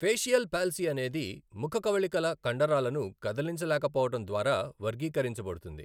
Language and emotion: Telugu, neutral